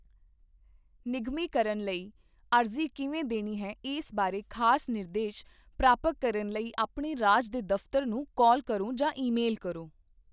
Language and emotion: Punjabi, neutral